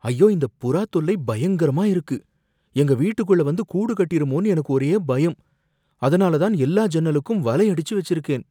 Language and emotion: Tamil, fearful